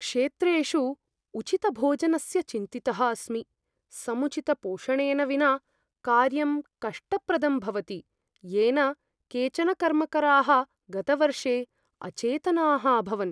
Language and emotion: Sanskrit, fearful